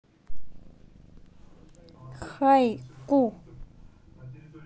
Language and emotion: Russian, neutral